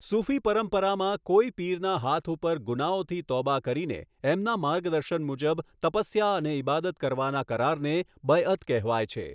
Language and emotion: Gujarati, neutral